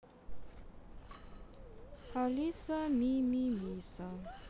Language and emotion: Russian, neutral